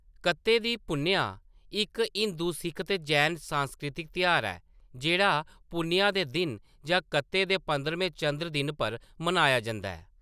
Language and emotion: Dogri, neutral